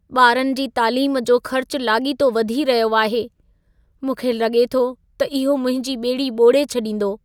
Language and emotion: Sindhi, sad